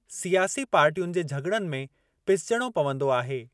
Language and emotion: Sindhi, neutral